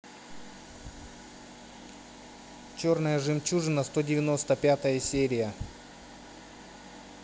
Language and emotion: Russian, neutral